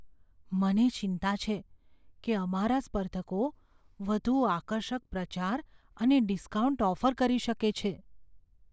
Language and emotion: Gujarati, fearful